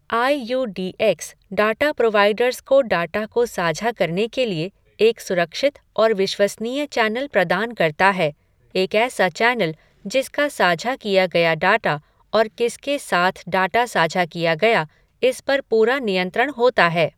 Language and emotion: Hindi, neutral